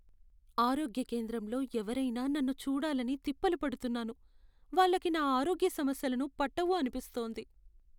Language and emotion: Telugu, sad